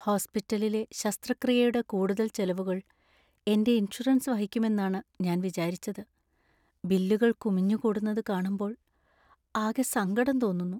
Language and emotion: Malayalam, sad